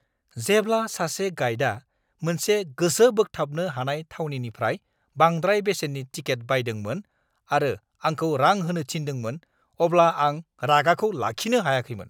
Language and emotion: Bodo, angry